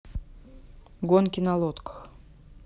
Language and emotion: Russian, neutral